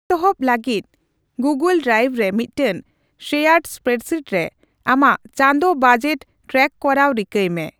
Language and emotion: Santali, neutral